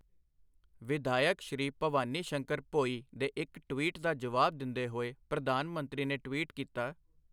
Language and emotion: Punjabi, neutral